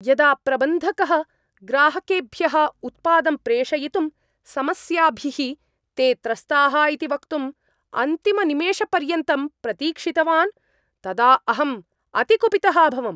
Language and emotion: Sanskrit, angry